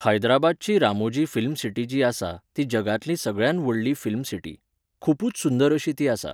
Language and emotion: Goan Konkani, neutral